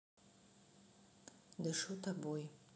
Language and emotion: Russian, neutral